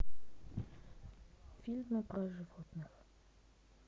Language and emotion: Russian, sad